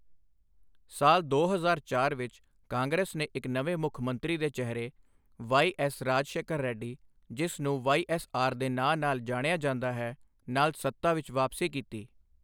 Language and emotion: Punjabi, neutral